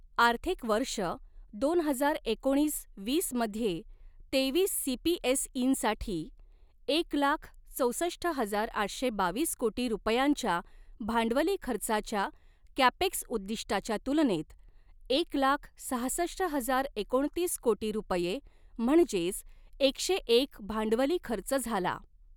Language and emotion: Marathi, neutral